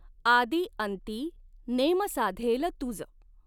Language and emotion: Marathi, neutral